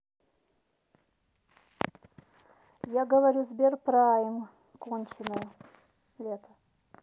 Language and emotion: Russian, neutral